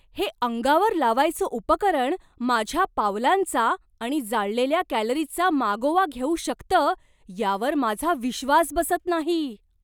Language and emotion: Marathi, surprised